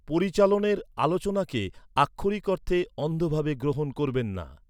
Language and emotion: Bengali, neutral